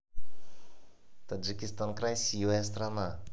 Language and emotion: Russian, positive